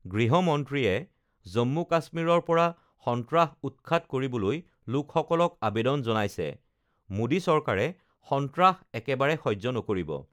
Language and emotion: Assamese, neutral